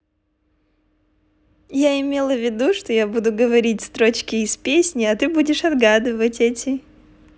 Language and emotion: Russian, positive